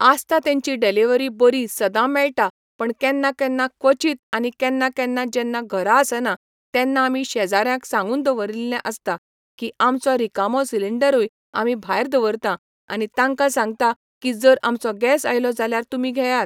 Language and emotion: Goan Konkani, neutral